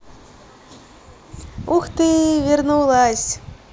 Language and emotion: Russian, positive